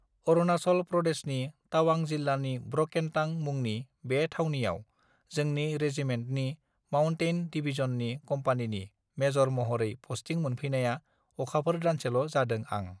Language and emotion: Bodo, neutral